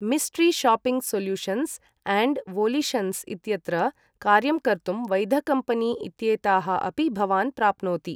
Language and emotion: Sanskrit, neutral